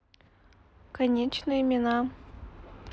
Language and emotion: Russian, neutral